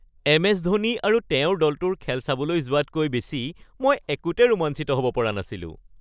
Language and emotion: Assamese, happy